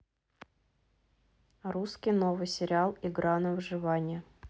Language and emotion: Russian, neutral